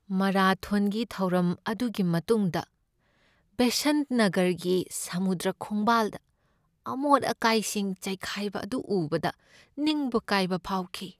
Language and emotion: Manipuri, sad